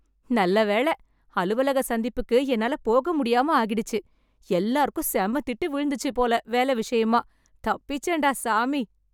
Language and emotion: Tamil, happy